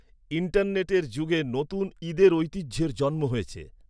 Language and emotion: Bengali, neutral